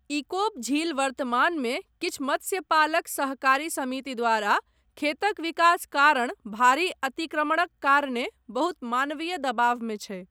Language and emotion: Maithili, neutral